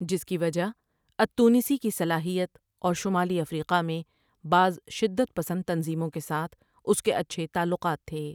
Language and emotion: Urdu, neutral